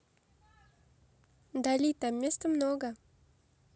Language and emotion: Russian, neutral